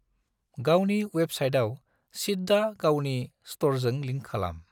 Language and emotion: Bodo, neutral